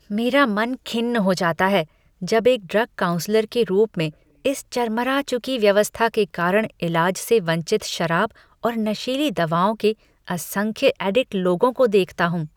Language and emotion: Hindi, disgusted